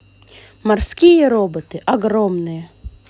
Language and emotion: Russian, positive